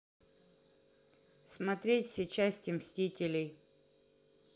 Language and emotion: Russian, neutral